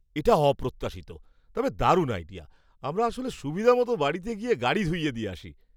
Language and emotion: Bengali, surprised